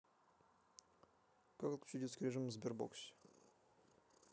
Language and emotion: Russian, neutral